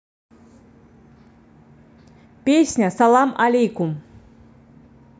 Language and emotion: Russian, positive